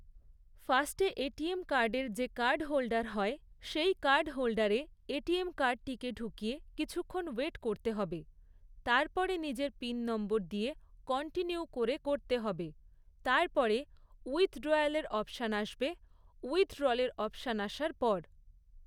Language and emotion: Bengali, neutral